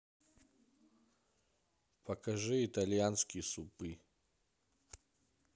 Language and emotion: Russian, neutral